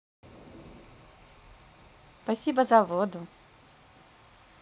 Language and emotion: Russian, positive